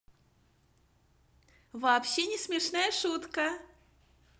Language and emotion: Russian, positive